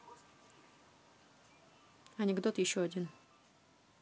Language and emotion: Russian, neutral